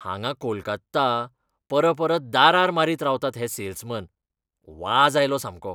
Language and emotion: Goan Konkani, disgusted